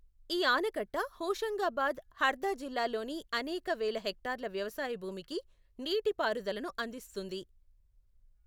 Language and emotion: Telugu, neutral